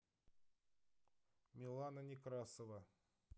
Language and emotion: Russian, neutral